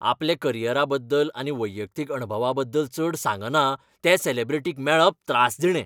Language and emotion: Goan Konkani, angry